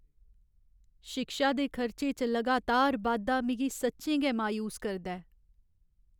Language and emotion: Dogri, sad